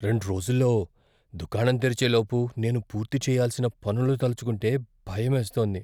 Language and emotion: Telugu, fearful